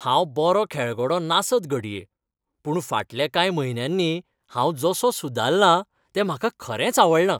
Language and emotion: Goan Konkani, happy